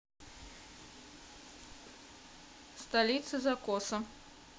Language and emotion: Russian, neutral